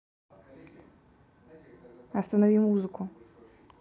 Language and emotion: Russian, neutral